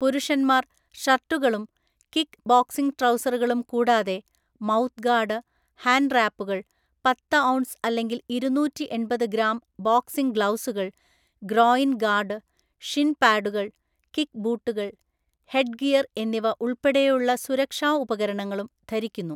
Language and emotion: Malayalam, neutral